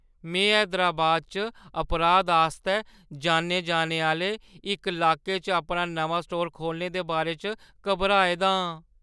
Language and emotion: Dogri, fearful